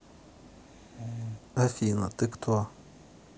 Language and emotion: Russian, neutral